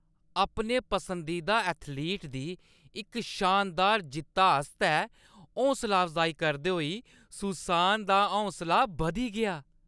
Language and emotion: Dogri, happy